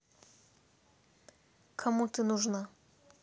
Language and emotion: Russian, neutral